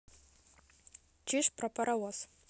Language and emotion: Russian, neutral